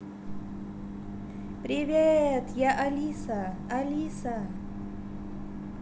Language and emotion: Russian, positive